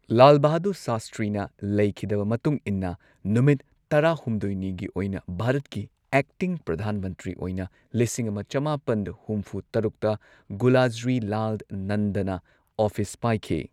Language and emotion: Manipuri, neutral